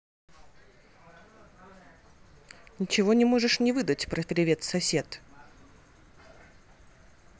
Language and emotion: Russian, neutral